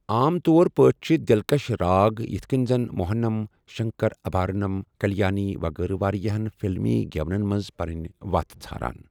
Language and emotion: Kashmiri, neutral